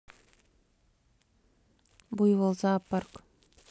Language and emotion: Russian, neutral